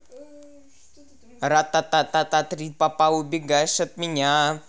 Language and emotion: Russian, positive